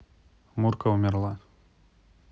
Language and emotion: Russian, neutral